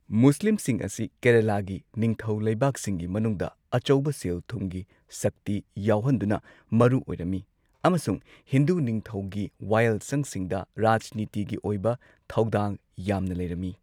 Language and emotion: Manipuri, neutral